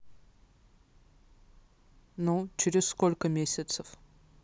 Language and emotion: Russian, neutral